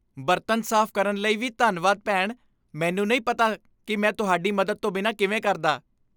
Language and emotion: Punjabi, happy